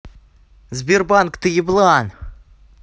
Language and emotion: Russian, angry